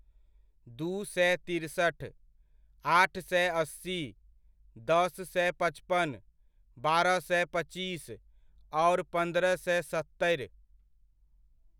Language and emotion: Maithili, neutral